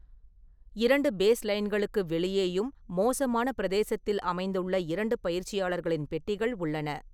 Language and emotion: Tamil, neutral